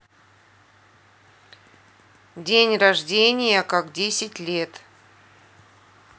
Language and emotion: Russian, neutral